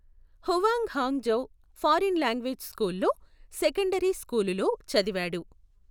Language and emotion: Telugu, neutral